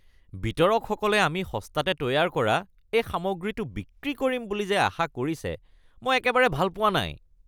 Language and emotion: Assamese, disgusted